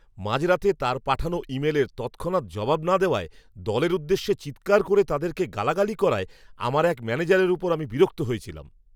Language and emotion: Bengali, angry